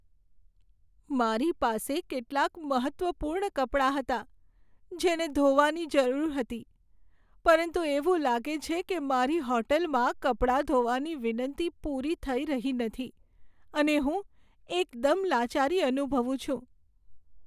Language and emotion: Gujarati, sad